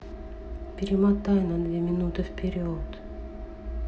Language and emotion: Russian, sad